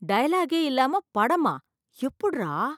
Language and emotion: Tamil, surprised